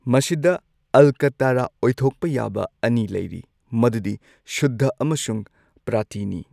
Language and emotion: Manipuri, neutral